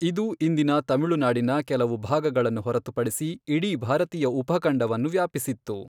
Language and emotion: Kannada, neutral